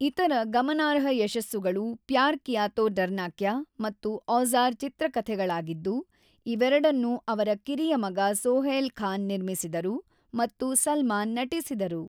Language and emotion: Kannada, neutral